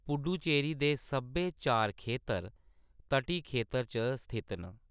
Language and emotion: Dogri, neutral